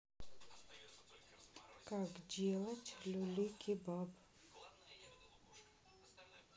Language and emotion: Russian, neutral